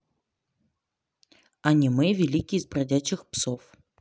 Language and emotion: Russian, neutral